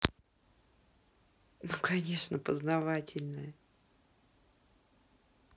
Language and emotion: Russian, positive